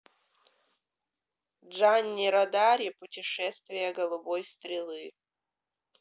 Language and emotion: Russian, neutral